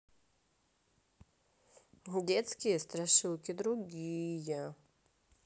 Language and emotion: Russian, sad